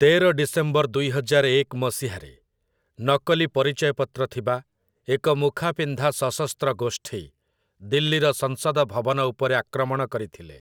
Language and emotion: Odia, neutral